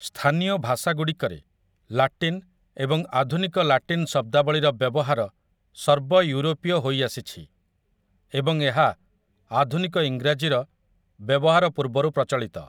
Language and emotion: Odia, neutral